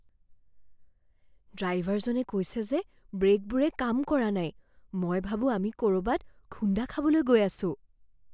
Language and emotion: Assamese, fearful